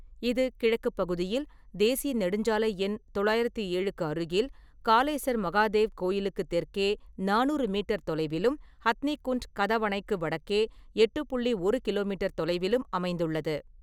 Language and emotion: Tamil, neutral